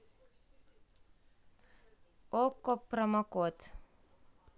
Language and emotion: Russian, neutral